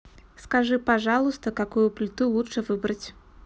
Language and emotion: Russian, neutral